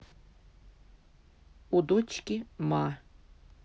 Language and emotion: Russian, neutral